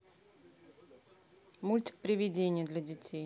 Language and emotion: Russian, neutral